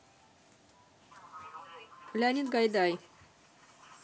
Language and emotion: Russian, neutral